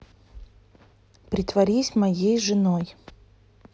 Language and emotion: Russian, neutral